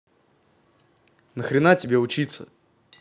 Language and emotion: Russian, angry